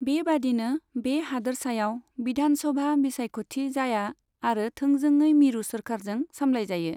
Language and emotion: Bodo, neutral